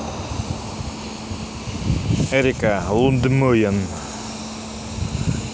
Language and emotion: Russian, neutral